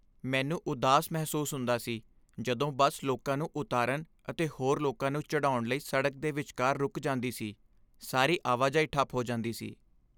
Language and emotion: Punjabi, sad